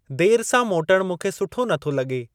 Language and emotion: Sindhi, neutral